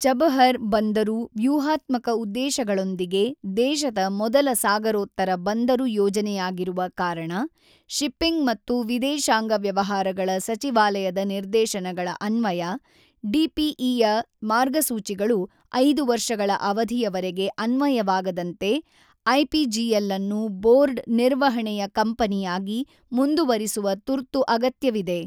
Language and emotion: Kannada, neutral